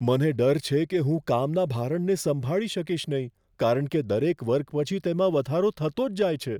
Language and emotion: Gujarati, fearful